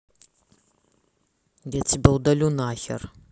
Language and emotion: Russian, angry